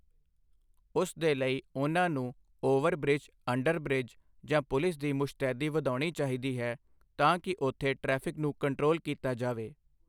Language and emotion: Punjabi, neutral